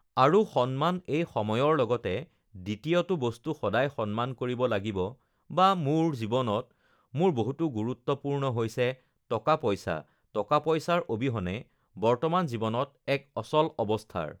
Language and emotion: Assamese, neutral